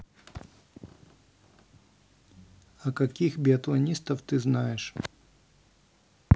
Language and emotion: Russian, neutral